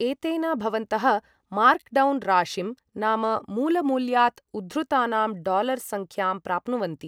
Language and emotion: Sanskrit, neutral